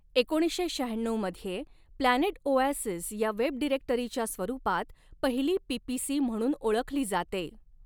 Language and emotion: Marathi, neutral